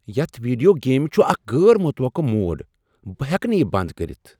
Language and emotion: Kashmiri, surprised